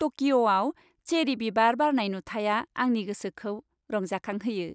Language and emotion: Bodo, happy